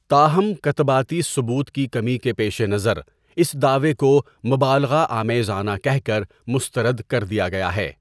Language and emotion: Urdu, neutral